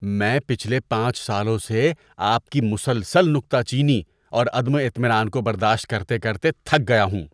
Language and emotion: Urdu, disgusted